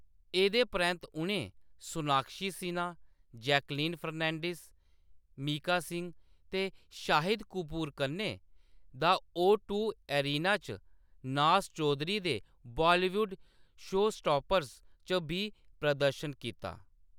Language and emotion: Dogri, neutral